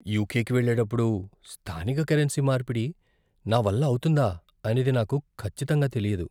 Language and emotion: Telugu, fearful